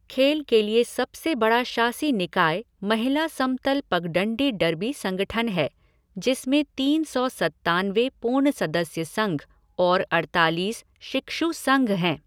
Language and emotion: Hindi, neutral